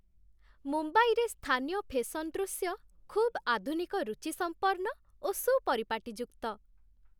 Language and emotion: Odia, happy